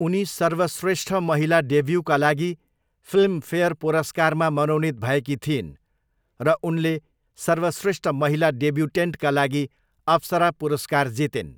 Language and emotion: Nepali, neutral